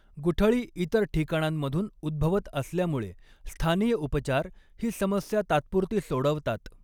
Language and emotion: Marathi, neutral